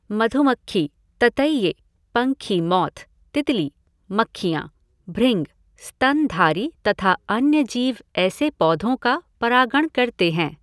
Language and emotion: Hindi, neutral